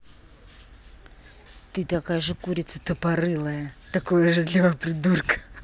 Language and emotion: Russian, angry